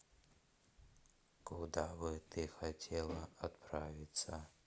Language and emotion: Russian, neutral